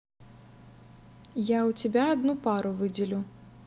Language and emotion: Russian, neutral